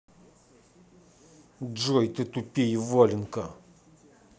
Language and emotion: Russian, angry